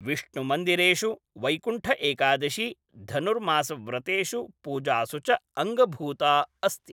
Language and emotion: Sanskrit, neutral